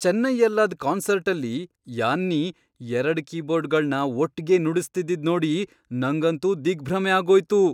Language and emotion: Kannada, surprised